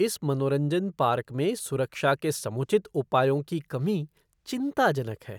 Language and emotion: Hindi, disgusted